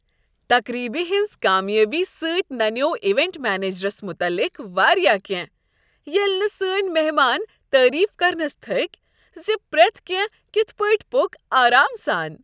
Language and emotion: Kashmiri, happy